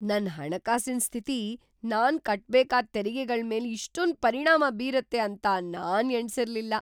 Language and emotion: Kannada, surprised